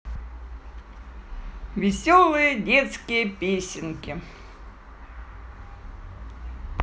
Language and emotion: Russian, positive